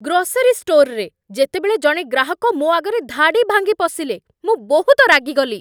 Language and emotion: Odia, angry